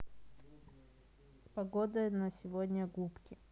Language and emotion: Russian, neutral